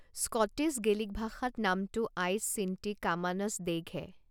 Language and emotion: Assamese, neutral